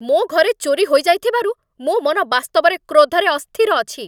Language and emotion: Odia, angry